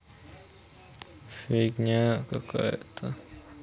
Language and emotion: Russian, sad